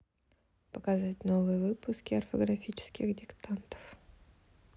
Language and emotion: Russian, neutral